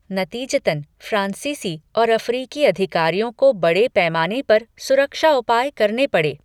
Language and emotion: Hindi, neutral